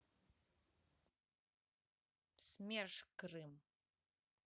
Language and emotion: Russian, neutral